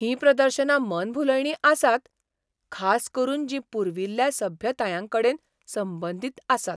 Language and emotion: Goan Konkani, surprised